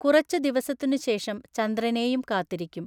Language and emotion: Malayalam, neutral